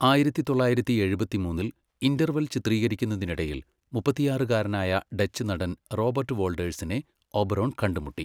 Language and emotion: Malayalam, neutral